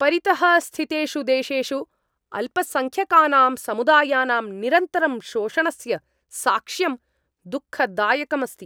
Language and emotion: Sanskrit, angry